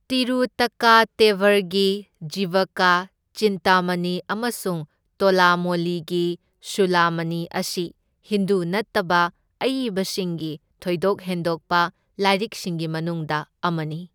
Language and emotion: Manipuri, neutral